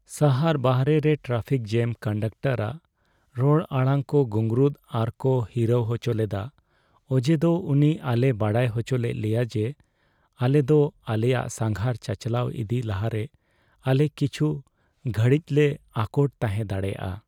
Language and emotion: Santali, sad